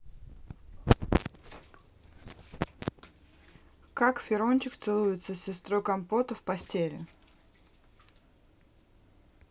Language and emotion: Russian, neutral